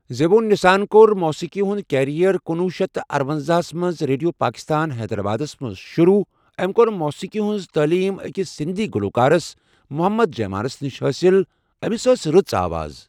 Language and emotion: Kashmiri, neutral